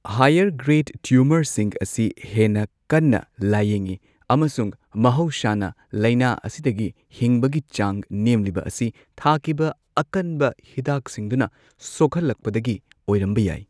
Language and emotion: Manipuri, neutral